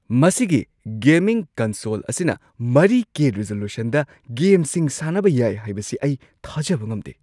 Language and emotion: Manipuri, surprised